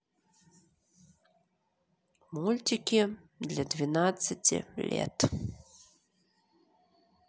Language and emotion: Russian, neutral